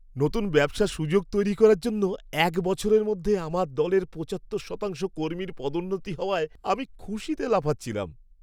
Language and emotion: Bengali, happy